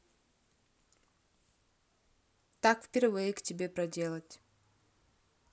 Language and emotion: Russian, neutral